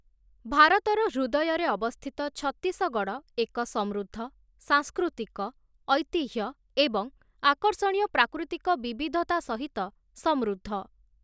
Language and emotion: Odia, neutral